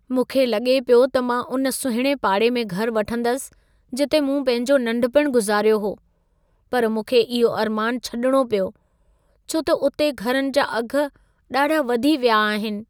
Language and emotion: Sindhi, sad